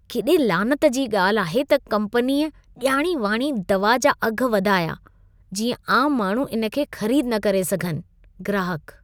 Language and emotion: Sindhi, disgusted